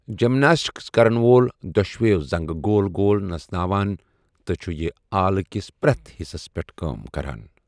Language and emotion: Kashmiri, neutral